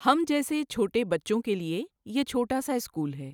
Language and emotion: Urdu, neutral